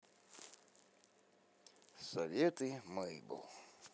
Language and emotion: Russian, neutral